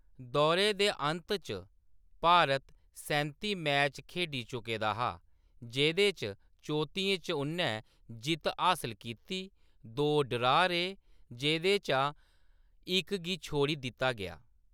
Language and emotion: Dogri, neutral